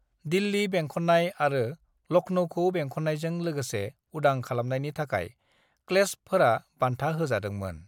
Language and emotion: Bodo, neutral